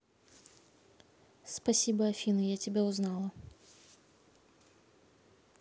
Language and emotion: Russian, neutral